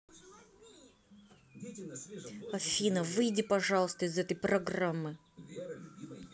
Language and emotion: Russian, angry